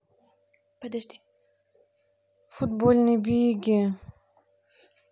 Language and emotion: Russian, neutral